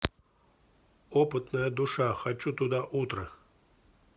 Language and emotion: Russian, neutral